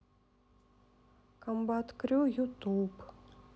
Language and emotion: Russian, sad